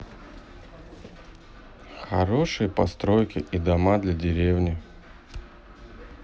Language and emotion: Russian, neutral